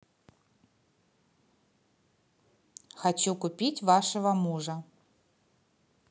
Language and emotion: Russian, positive